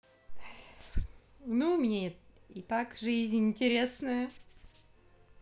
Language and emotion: Russian, positive